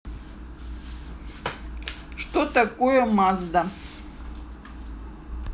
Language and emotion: Russian, neutral